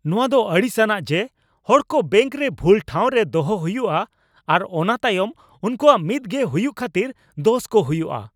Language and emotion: Santali, angry